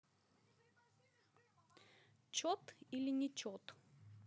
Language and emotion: Russian, neutral